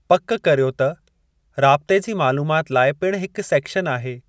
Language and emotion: Sindhi, neutral